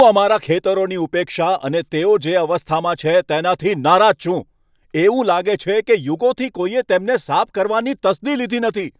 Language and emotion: Gujarati, angry